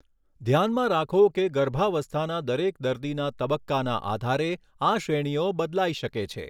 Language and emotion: Gujarati, neutral